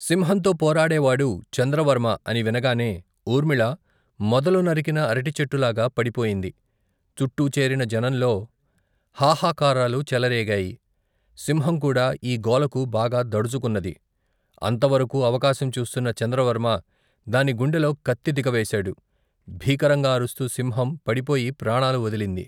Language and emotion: Telugu, neutral